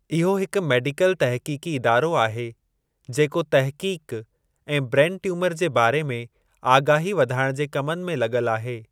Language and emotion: Sindhi, neutral